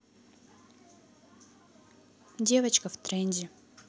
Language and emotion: Russian, neutral